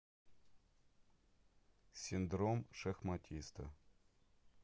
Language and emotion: Russian, neutral